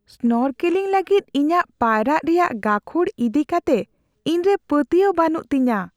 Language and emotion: Santali, fearful